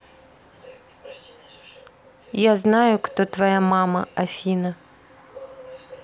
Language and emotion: Russian, neutral